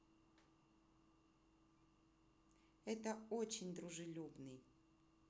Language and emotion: Russian, positive